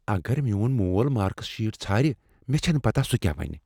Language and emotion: Kashmiri, fearful